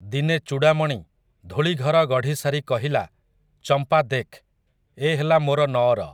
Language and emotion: Odia, neutral